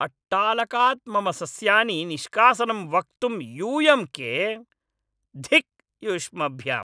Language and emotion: Sanskrit, angry